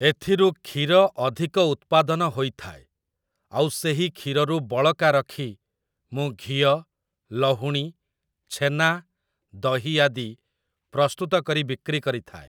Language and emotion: Odia, neutral